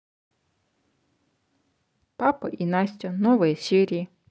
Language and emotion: Russian, neutral